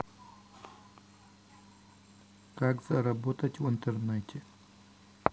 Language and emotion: Russian, neutral